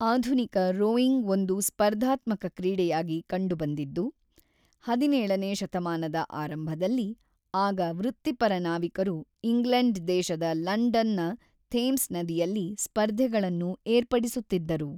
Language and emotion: Kannada, neutral